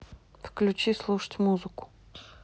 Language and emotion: Russian, neutral